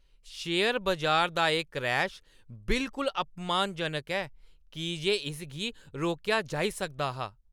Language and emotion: Dogri, angry